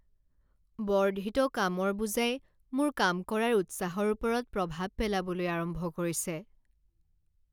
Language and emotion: Assamese, sad